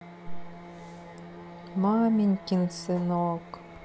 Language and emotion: Russian, sad